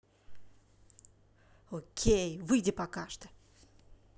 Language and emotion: Russian, angry